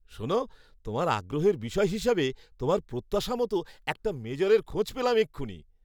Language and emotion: Bengali, happy